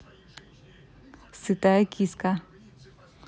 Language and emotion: Russian, neutral